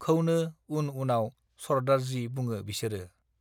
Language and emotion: Bodo, neutral